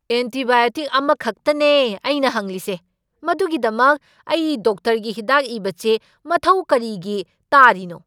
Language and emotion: Manipuri, angry